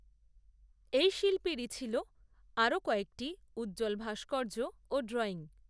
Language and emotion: Bengali, neutral